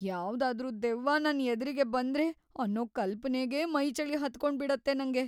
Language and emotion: Kannada, fearful